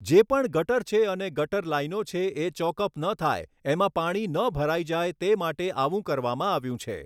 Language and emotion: Gujarati, neutral